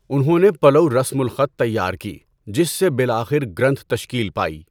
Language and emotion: Urdu, neutral